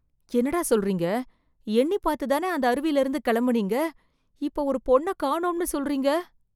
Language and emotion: Tamil, fearful